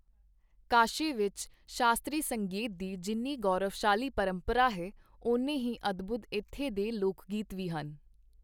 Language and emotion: Punjabi, neutral